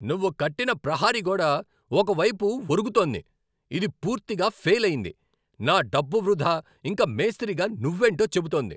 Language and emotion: Telugu, angry